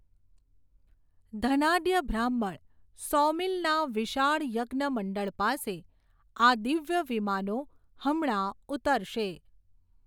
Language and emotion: Gujarati, neutral